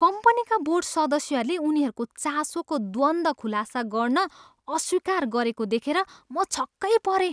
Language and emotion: Nepali, disgusted